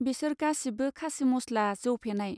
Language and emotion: Bodo, neutral